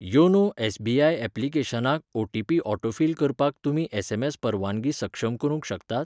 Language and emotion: Goan Konkani, neutral